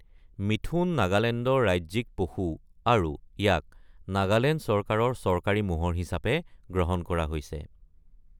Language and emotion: Assamese, neutral